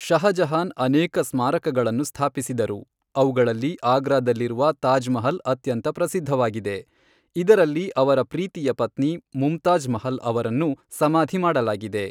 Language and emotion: Kannada, neutral